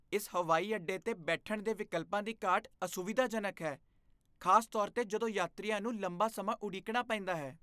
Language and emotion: Punjabi, disgusted